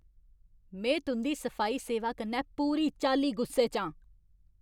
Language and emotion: Dogri, angry